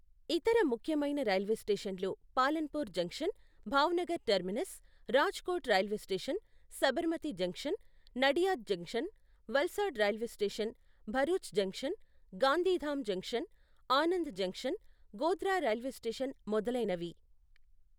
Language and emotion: Telugu, neutral